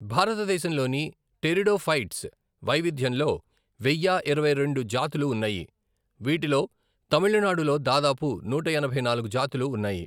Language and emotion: Telugu, neutral